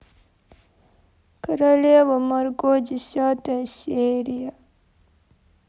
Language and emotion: Russian, sad